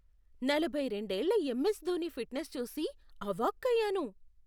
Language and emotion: Telugu, surprised